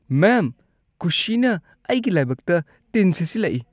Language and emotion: Manipuri, disgusted